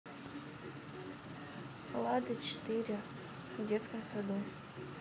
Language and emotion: Russian, neutral